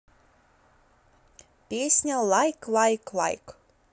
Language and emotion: Russian, neutral